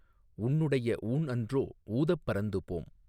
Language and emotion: Tamil, neutral